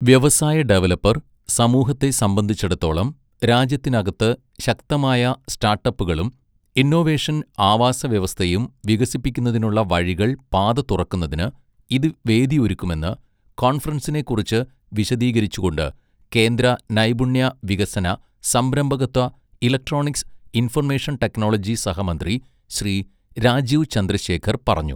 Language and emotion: Malayalam, neutral